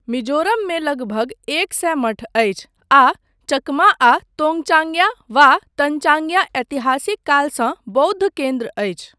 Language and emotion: Maithili, neutral